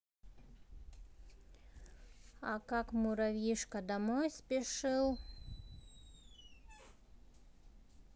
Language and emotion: Russian, neutral